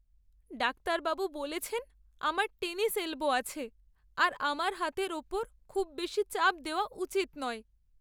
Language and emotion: Bengali, sad